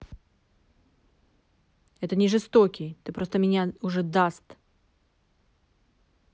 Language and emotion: Russian, angry